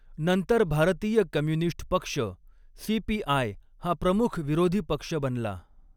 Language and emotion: Marathi, neutral